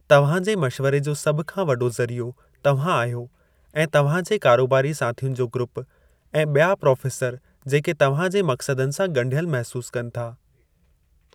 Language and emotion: Sindhi, neutral